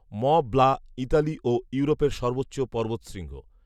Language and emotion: Bengali, neutral